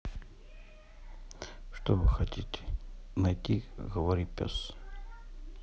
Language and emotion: Russian, neutral